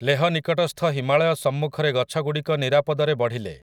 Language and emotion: Odia, neutral